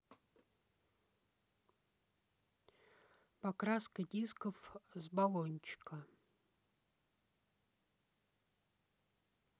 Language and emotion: Russian, neutral